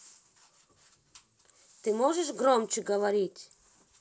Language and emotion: Russian, angry